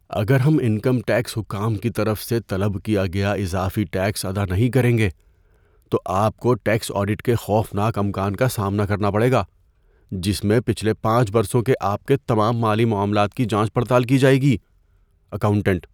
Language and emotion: Urdu, fearful